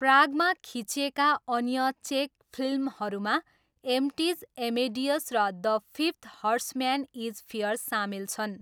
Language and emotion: Nepali, neutral